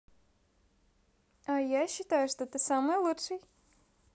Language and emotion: Russian, positive